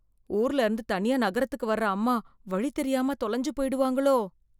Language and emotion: Tamil, fearful